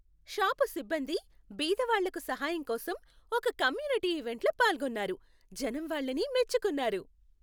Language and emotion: Telugu, happy